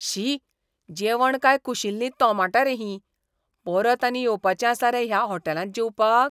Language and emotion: Goan Konkani, disgusted